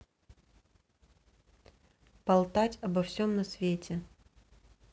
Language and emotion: Russian, neutral